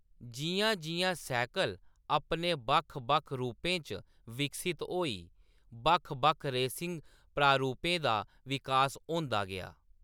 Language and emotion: Dogri, neutral